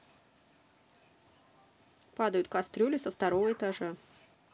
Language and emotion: Russian, neutral